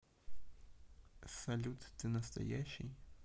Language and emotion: Russian, neutral